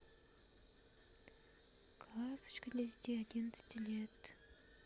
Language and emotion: Russian, neutral